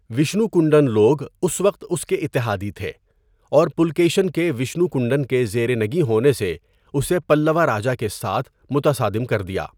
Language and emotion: Urdu, neutral